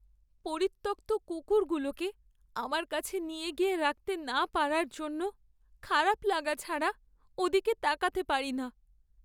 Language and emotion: Bengali, sad